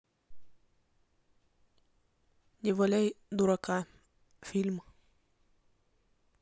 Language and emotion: Russian, neutral